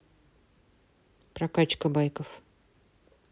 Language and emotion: Russian, neutral